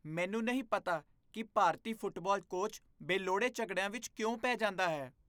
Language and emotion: Punjabi, disgusted